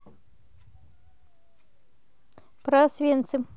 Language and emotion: Russian, neutral